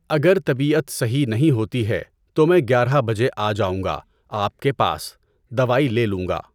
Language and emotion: Urdu, neutral